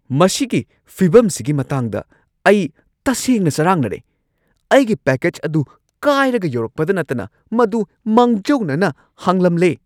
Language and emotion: Manipuri, angry